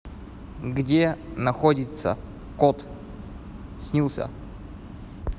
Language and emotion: Russian, neutral